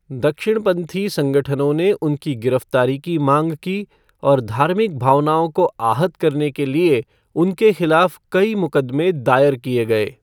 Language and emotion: Hindi, neutral